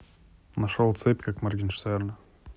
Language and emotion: Russian, neutral